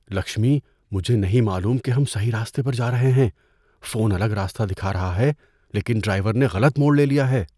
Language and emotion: Urdu, fearful